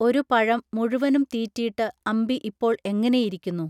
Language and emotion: Malayalam, neutral